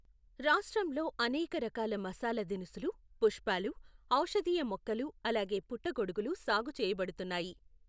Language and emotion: Telugu, neutral